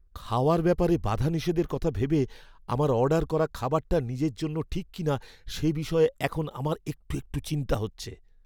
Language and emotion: Bengali, fearful